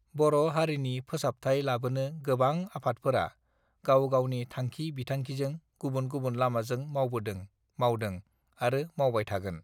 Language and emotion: Bodo, neutral